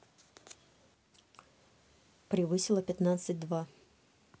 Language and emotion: Russian, neutral